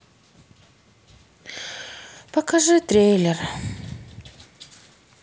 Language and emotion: Russian, sad